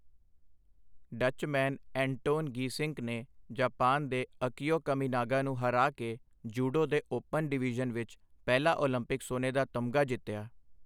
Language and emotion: Punjabi, neutral